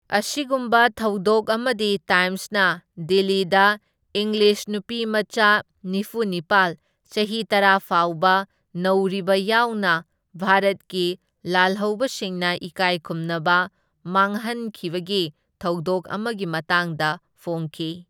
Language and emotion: Manipuri, neutral